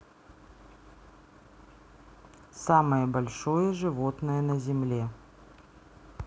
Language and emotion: Russian, neutral